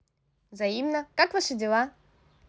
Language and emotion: Russian, positive